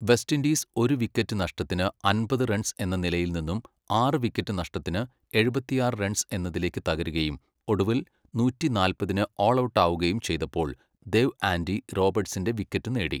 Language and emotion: Malayalam, neutral